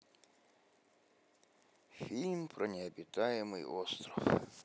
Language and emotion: Russian, sad